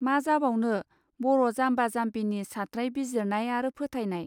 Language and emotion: Bodo, neutral